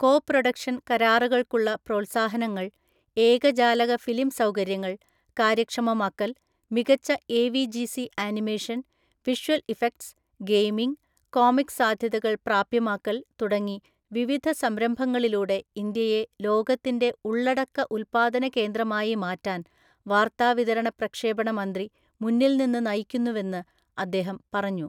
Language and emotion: Malayalam, neutral